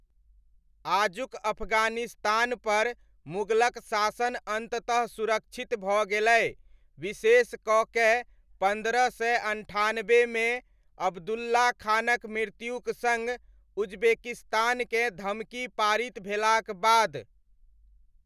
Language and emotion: Maithili, neutral